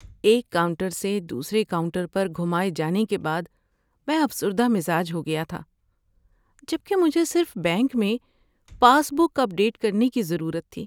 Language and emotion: Urdu, sad